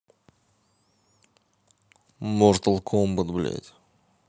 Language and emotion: Russian, neutral